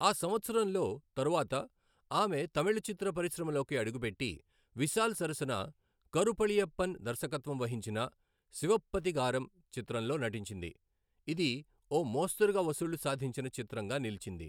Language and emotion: Telugu, neutral